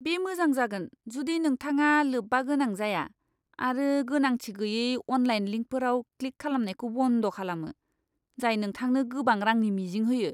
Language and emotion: Bodo, disgusted